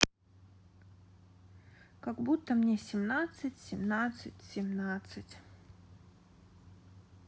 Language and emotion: Russian, neutral